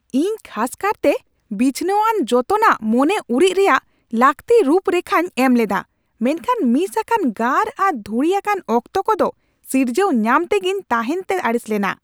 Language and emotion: Santali, angry